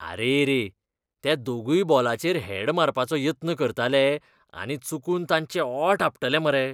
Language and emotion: Goan Konkani, disgusted